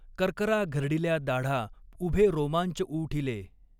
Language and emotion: Marathi, neutral